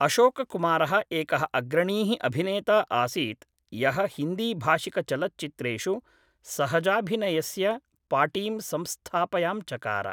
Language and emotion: Sanskrit, neutral